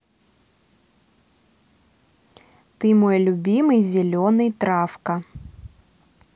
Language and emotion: Russian, positive